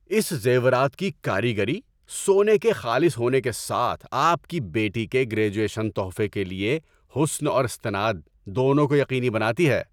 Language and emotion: Urdu, happy